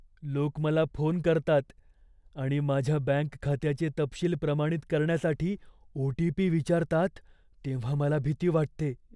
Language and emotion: Marathi, fearful